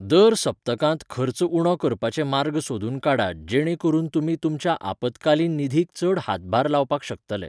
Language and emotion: Goan Konkani, neutral